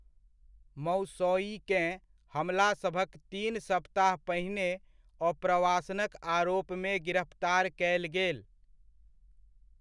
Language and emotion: Maithili, neutral